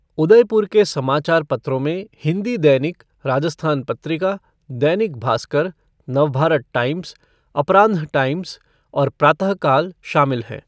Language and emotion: Hindi, neutral